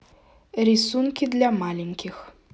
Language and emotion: Russian, neutral